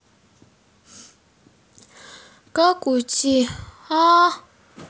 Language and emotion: Russian, sad